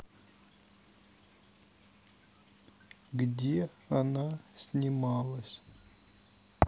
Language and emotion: Russian, neutral